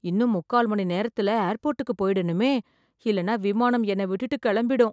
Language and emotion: Tamil, fearful